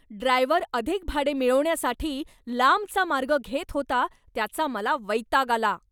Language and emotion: Marathi, angry